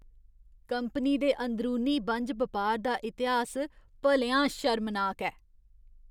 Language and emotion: Dogri, disgusted